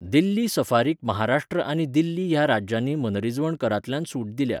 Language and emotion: Goan Konkani, neutral